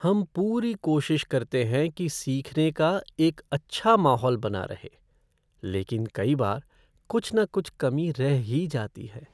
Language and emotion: Hindi, sad